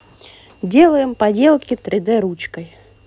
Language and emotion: Russian, positive